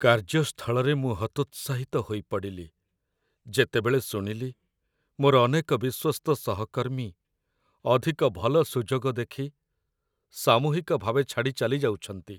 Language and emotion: Odia, sad